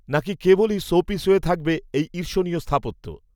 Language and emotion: Bengali, neutral